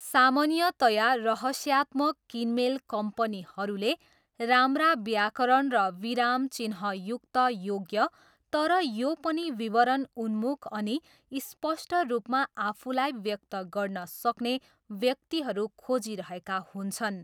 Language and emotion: Nepali, neutral